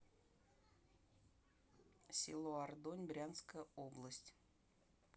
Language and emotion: Russian, neutral